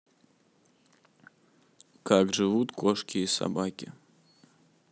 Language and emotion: Russian, neutral